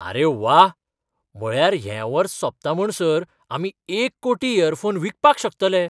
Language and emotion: Goan Konkani, surprised